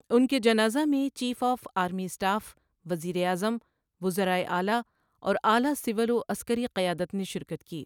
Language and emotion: Urdu, neutral